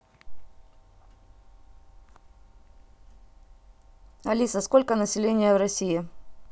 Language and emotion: Russian, neutral